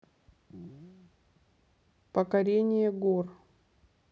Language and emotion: Russian, neutral